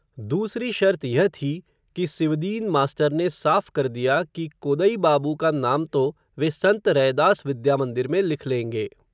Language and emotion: Hindi, neutral